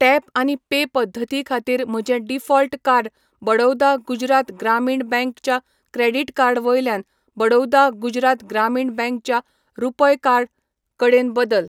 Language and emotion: Goan Konkani, neutral